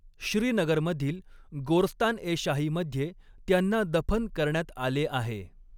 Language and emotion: Marathi, neutral